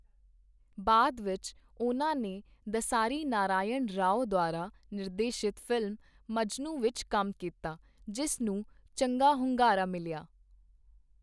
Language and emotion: Punjabi, neutral